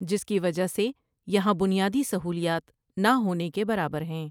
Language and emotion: Urdu, neutral